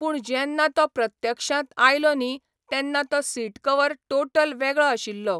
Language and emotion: Goan Konkani, neutral